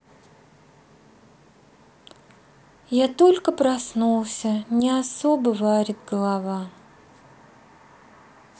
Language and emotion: Russian, sad